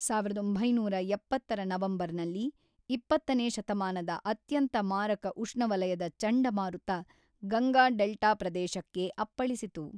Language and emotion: Kannada, neutral